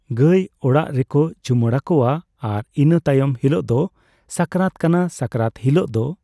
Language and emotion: Santali, neutral